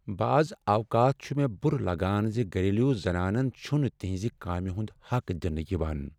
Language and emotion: Kashmiri, sad